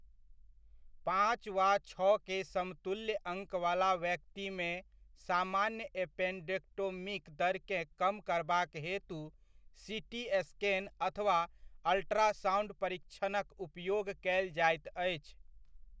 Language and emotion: Maithili, neutral